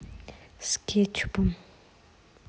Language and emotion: Russian, neutral